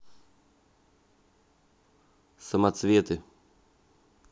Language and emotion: Russian, neutral